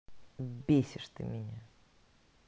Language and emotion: Russian, angry